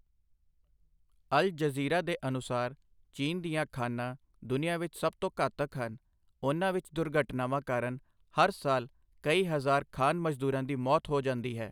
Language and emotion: Punjabi, neutral